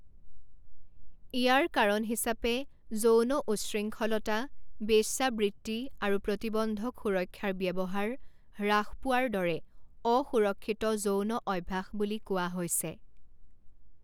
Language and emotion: Assamese, neutral